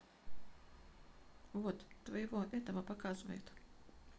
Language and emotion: Russian, neutral